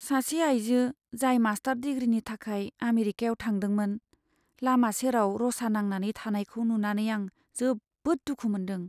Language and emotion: Bodo, sad